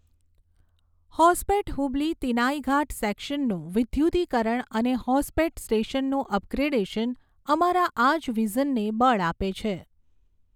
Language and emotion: Gujarati, neutral